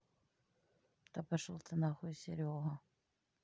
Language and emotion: Russian, neutral